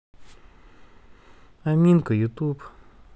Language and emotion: Russian, sad